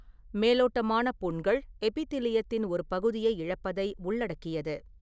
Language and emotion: Tamil, neutral